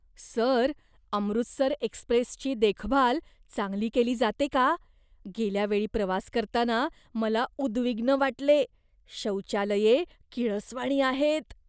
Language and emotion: Marathi, disgusted